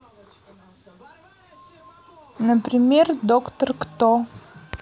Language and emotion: Russian, neutral